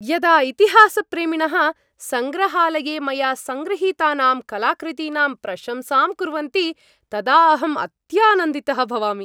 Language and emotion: Sanskrit, happy